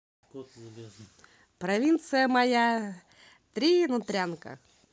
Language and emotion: Russian, positive